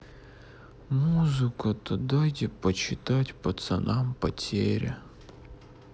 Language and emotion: Russian, sad